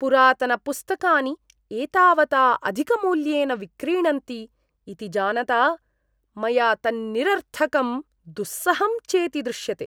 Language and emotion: Sanskrit, disgusted